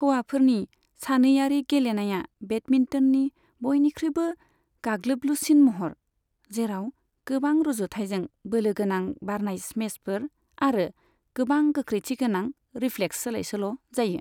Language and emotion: Bodo, neutral